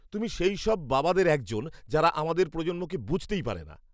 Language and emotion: Bengali, disgusted